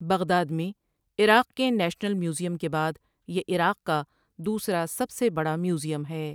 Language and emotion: Urdu, neutral